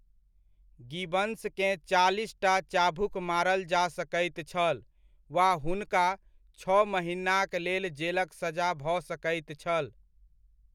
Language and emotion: Maithili, neutral